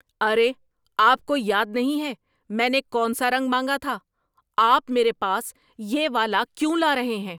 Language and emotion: Urdu, angry